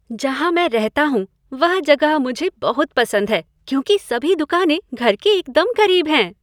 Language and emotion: Hindi, happy